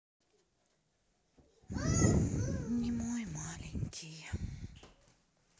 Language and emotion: Russian, sad